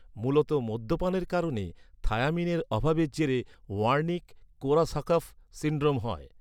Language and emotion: Bengali, neutral